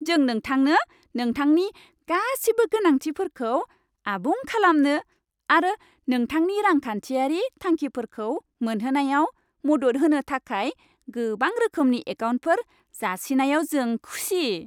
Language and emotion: Bodo, happy